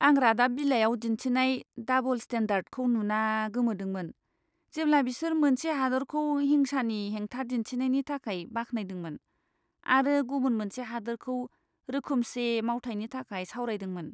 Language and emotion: Bodo, disgusted